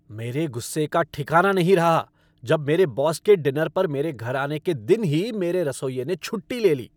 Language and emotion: Hindi, angry